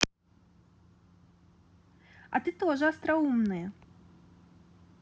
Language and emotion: Russian, positive